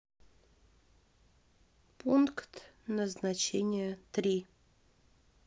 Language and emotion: Russian, neutral